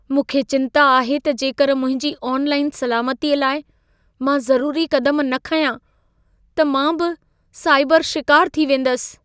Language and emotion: Sindhi, fearful